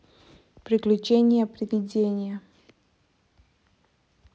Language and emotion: Russian, neutral